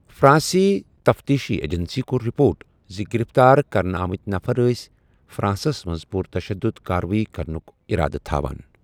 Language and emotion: Kashmiri, neutral